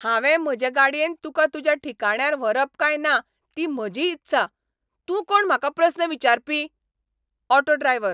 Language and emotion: Goan Konkani, angry